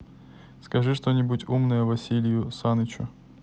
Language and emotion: Russian, neutral